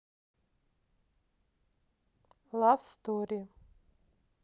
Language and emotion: Russian, neutral